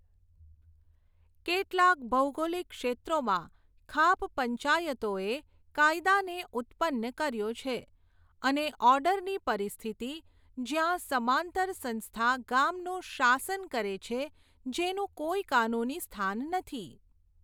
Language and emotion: Gujarati, neutral